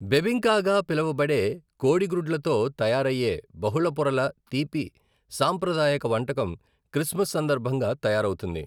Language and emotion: Telugu, neutral